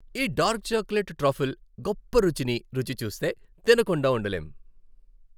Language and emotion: Telugu, happy